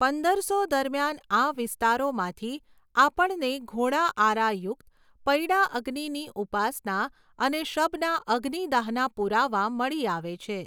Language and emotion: Gujarati, neutral